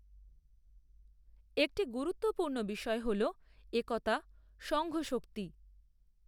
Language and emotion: Bengali, neutral